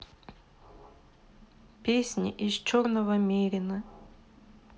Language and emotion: Russian, sad